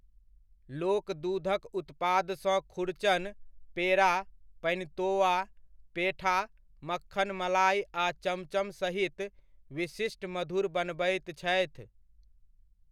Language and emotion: Maithili, neutral